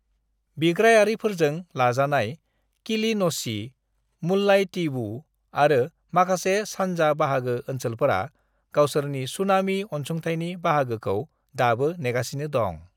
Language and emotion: Bodo, neutral